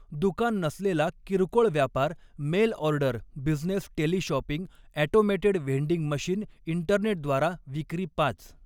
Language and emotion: Marathi, neutral